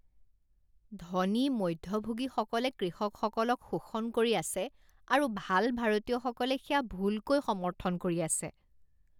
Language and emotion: Assamese, disgusted